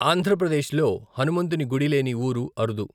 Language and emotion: Telugu, neutral